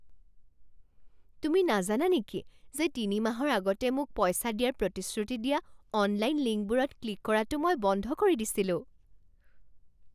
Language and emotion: Assamese, surprised